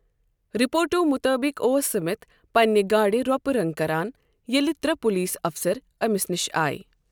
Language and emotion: Kashmiri, neutral